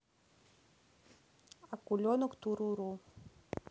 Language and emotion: Russian, neutral